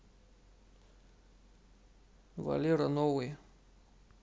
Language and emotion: Russian, neutral